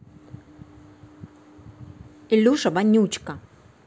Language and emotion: Russian, angry